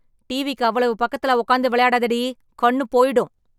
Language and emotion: Tamil, angry